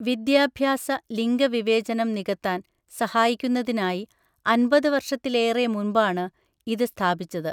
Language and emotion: Malayalam, neutral